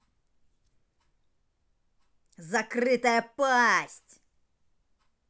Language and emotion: Russian, angry